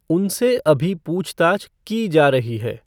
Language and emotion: Hindi, neutral